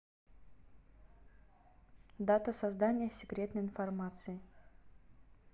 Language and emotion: Russian, neutral